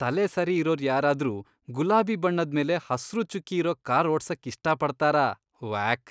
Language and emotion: Kannada, disgusted